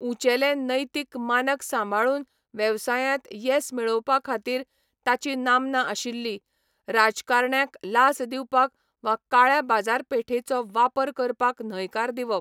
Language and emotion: Goan Konkani, neutral